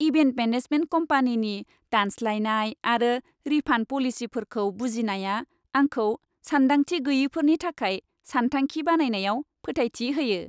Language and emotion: Bodo, happy